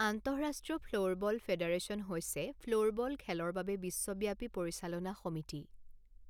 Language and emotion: Assamese, neutral